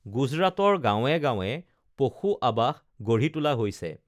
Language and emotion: Assamese, neutral